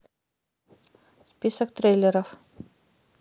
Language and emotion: Russian, neutral